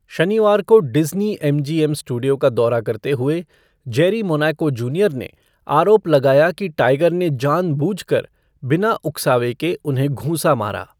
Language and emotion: Hindi, neutral